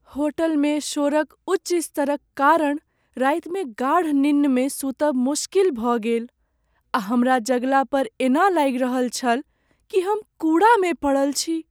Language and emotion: Maithili, sad